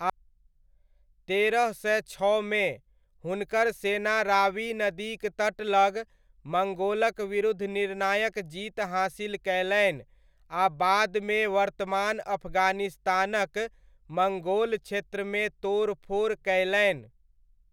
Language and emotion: Maithili, neutral